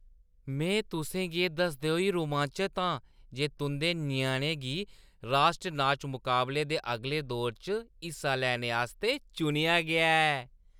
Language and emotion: Dogri, happy